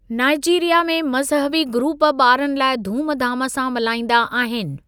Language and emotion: Sindhi, neutral